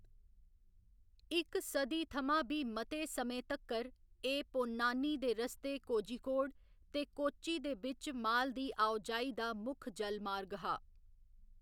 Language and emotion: Dogri, neutral